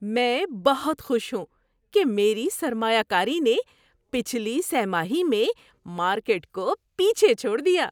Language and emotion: Urdu, happy